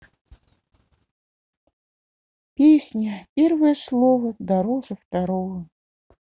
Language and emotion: Russian, sad